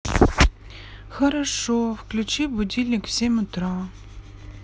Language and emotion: Russian, sad